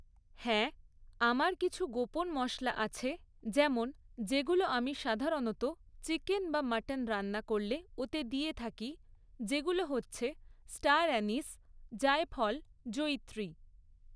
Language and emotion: Bengali, neutral